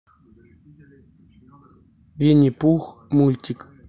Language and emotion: Russian, neutral